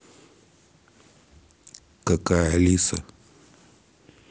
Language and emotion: Russian, neutral